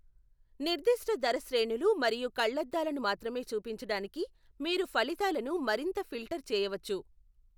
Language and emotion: Telugu, neutral